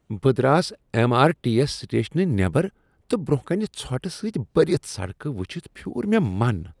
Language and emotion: Kashmiri, disgusted